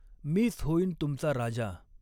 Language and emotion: Marathi, neutral